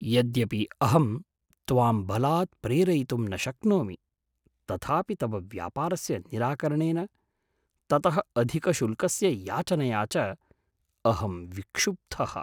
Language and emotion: Sanskrit, surprised